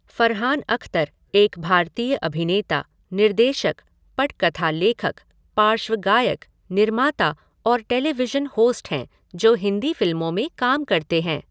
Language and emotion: Hindi, neutral